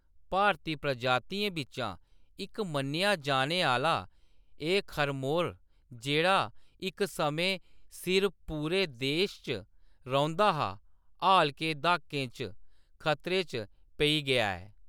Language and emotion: Dogri, neutral